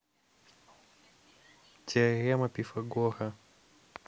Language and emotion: Russian, neutral